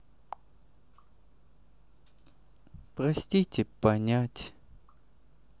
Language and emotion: Russian, sad